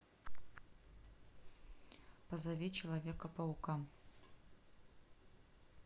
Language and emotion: Russian, neutral